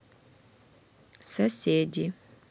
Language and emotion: Russian, neutral